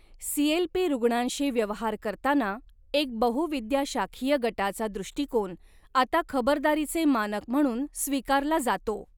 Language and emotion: Marathi, neutral